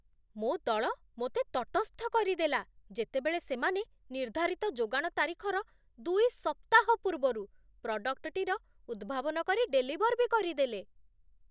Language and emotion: Odia, surprised